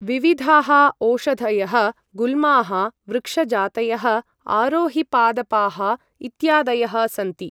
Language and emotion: Sanskrit, neutral